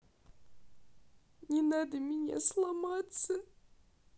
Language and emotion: Russian, sad